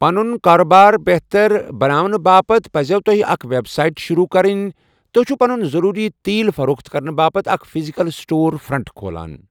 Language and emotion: Kashmiri, neutral